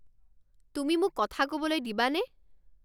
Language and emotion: Assamese, angry